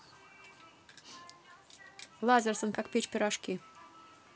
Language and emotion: Russian, neutral